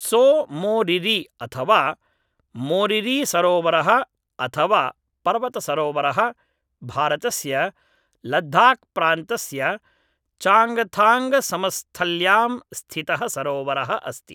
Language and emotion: Sanskrit, neutral